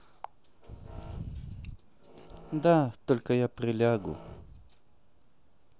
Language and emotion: Russian, sad